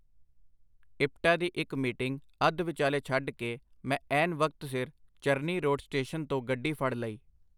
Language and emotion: Punjabi, neutral